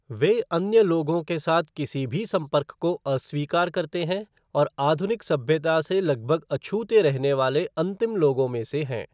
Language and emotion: Hindi, neutral